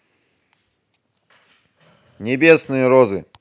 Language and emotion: Russian, neutral